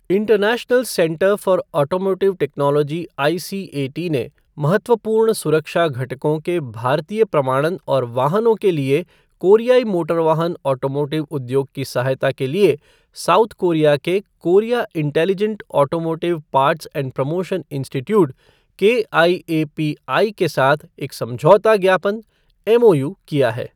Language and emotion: Hindi, neutral